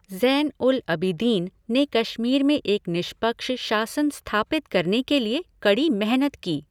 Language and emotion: Hindi, neutral